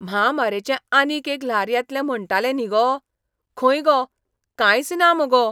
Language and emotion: Goan Konkani, surprised